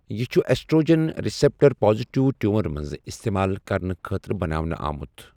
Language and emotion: Kashmiri, neutral